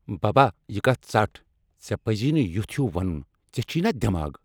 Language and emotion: Kashmiri, angry